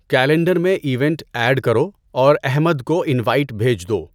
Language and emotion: Urdu, neutral